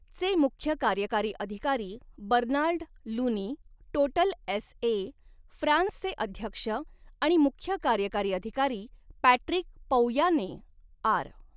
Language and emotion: Marathi, neutral